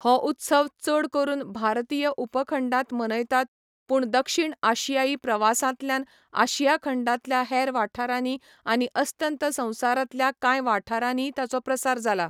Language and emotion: Goan Konkani, neutral